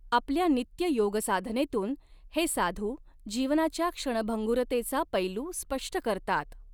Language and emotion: Marathi, neutral